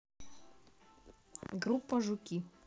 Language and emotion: Russian, neutral